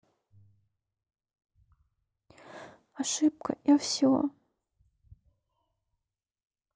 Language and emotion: Russian, sad